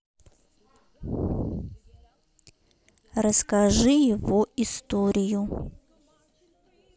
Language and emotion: Russian, neutral